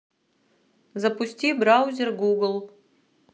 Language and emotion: Russian, neutral